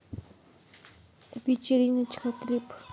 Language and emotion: Russian, neutral